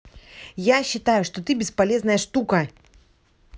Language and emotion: Russian, angry